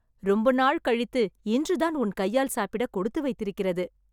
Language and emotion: Tamil, happy